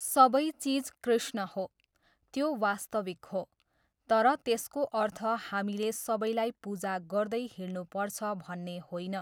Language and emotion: Nepali, neutral